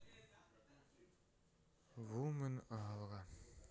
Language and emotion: Russian, sad